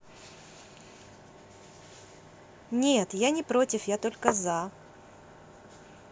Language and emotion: Russian, positive